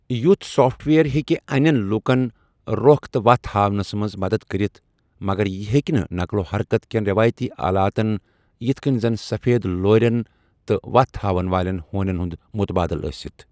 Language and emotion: Kashmiri, neutral